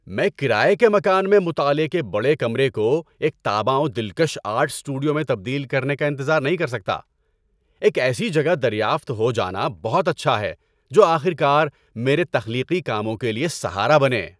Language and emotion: Urdu, happy